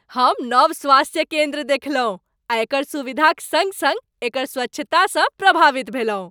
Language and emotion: Maithili, happy